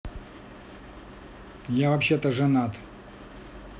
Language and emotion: Russian, angry